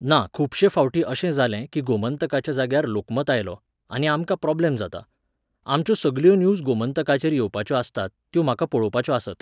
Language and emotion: Goan Konkani, neutral